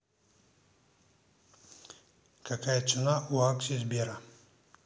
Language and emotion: Russian, neutral